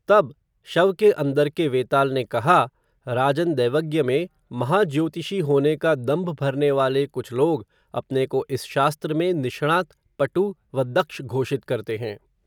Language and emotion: Hindi, neutral